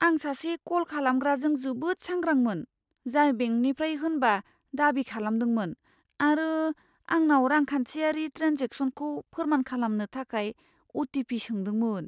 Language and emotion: Bodo, fearful